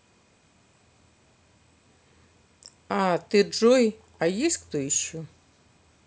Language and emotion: Russian, neutral